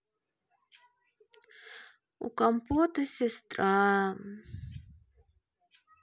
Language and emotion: Russian, sad